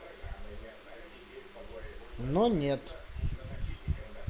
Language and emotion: Russian, neutral